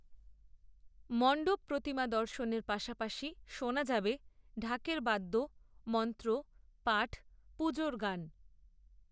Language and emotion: Bengali, neutral